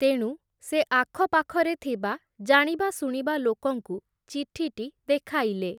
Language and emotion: Odia, neutral